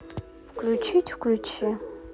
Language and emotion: Russian, neutral